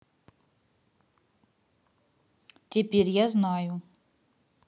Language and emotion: Russian, neutral